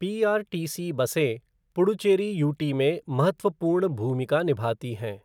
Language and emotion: Hindi, neutral